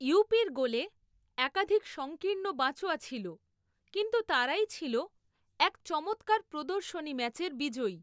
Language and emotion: Bengali, neutral